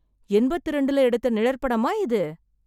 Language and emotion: Tamil, surprised